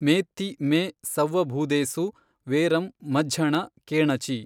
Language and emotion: Kannada, neutral